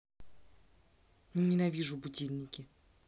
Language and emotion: Russian, angry